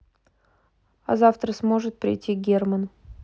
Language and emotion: Russian, neutral